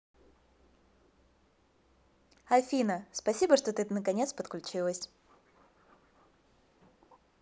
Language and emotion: Russian, positive